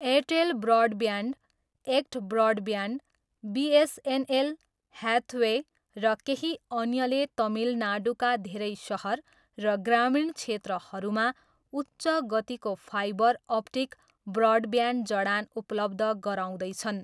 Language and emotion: Nepali, neutral